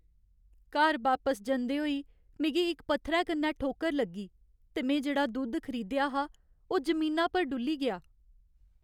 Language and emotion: Dogri, sad